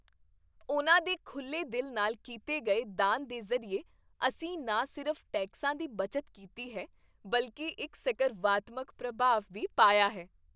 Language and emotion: Punjabi, happy